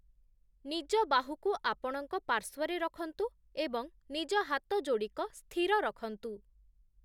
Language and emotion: Odia, neutral